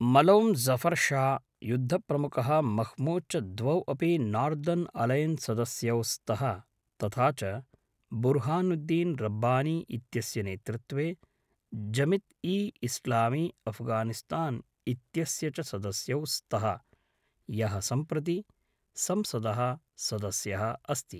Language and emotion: Sanskrit, neutral